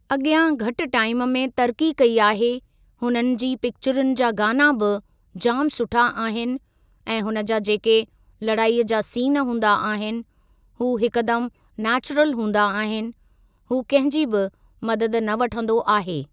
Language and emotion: Sindhi, neutral